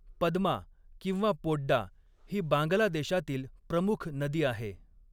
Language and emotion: Marathi, neutral